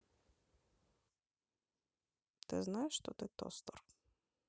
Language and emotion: Russian, neutral